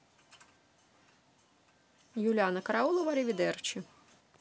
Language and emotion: Russian, neutral